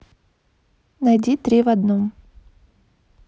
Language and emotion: Russian, neutral